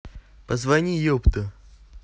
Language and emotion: Russian, neutral